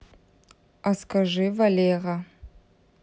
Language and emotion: Russian, neutral